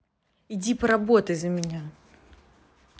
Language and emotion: Russian, angry